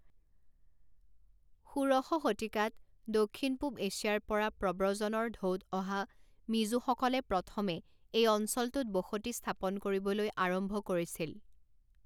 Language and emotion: Assamese, neutral